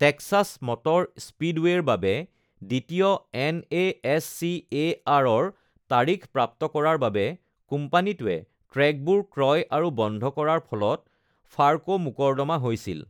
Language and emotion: Assamese, neutral